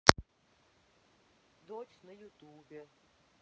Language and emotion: Russian, neutral